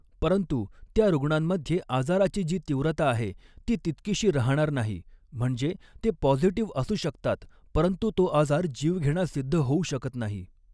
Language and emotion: Marathi, neutral